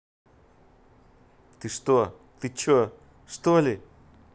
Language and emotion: Russian, angry